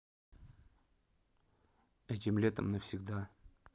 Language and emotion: Russian, neutral